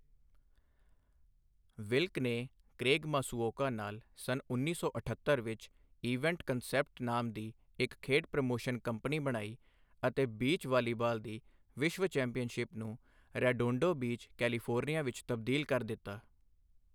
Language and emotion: Punjabi, neutral